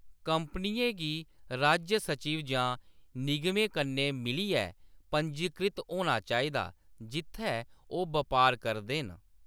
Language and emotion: Dogri, neutral